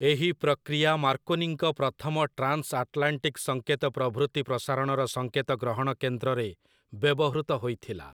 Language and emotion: Odia, neutral